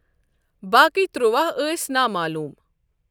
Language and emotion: Kashmiri, neutral